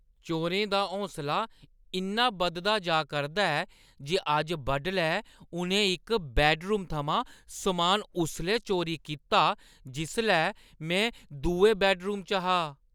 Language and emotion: Dogri, disgusted